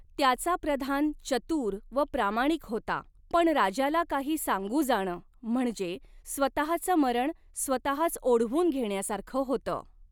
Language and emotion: Marathi, neutral